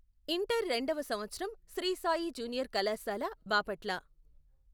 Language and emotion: Telugu, neutral